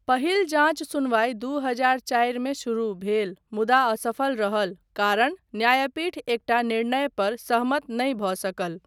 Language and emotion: Maithili, neutral